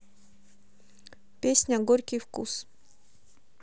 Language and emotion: Russian, neutral